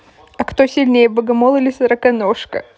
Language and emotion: Russian, positive